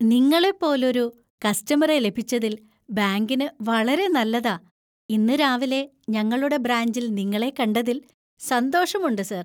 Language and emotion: Malayalam, happy